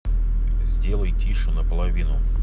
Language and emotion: Russian, neutral